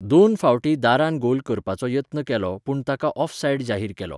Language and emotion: Goan Konkani, neutral